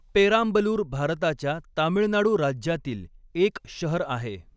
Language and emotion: Marathi, neutral